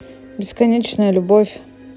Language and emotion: Russian, neutral